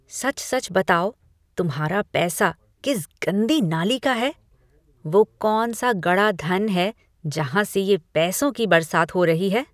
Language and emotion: Hindi, disgusted